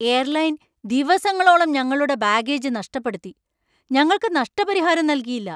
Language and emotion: Malayalam, angry